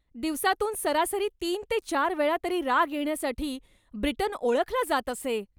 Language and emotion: Marathi, angry